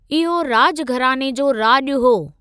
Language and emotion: Sindhi, neutral